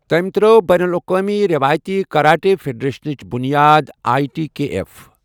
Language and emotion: Kashmiri, neutral